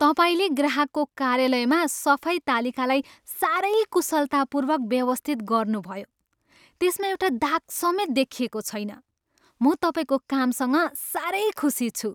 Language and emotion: Nepali, happy